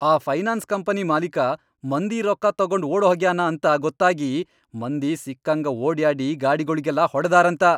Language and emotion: Kannada, angry